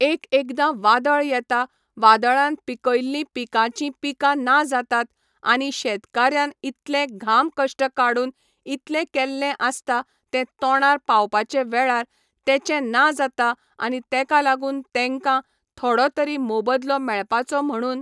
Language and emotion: Goan Konkani, neutral